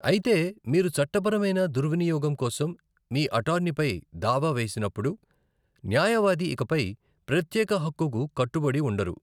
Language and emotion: Telugu, neutral